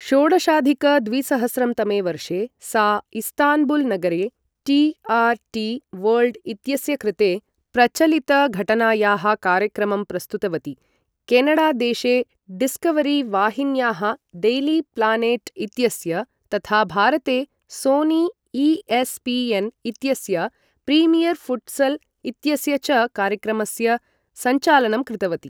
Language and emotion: Sanskrit, neutral